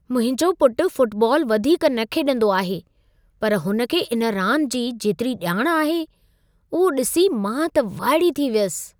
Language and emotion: Sindhi, surprised